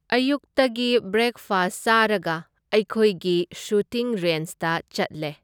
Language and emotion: Manipuri, neutral